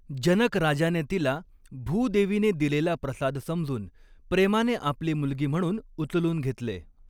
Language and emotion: Marathi, neutral